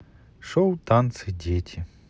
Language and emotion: Russian, neutral